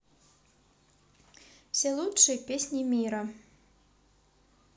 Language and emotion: Russian, neutral